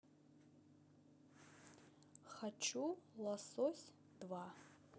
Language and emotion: Russian, neutral